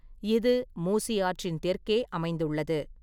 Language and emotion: Tamil, neutral